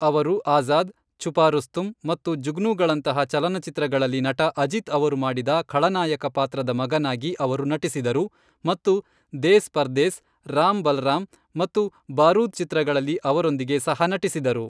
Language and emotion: Kannada, neutral